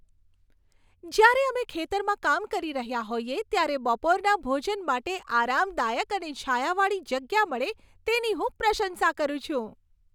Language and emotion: Gujarati, happy